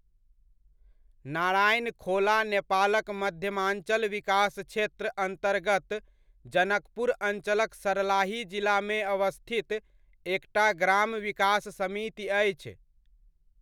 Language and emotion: Maithili, neutral